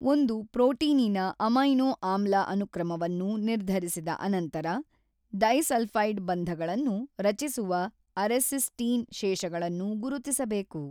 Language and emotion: Kannada, neutral